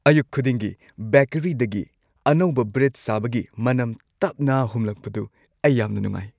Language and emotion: Manipuri, happy